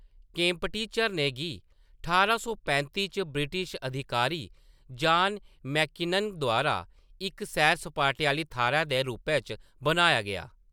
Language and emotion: Dogri, neutral